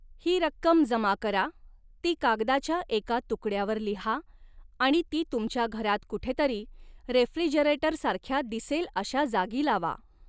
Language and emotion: Marathi, neutral